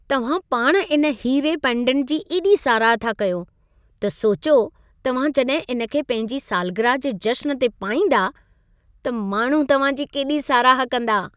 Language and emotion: Sindhi, happy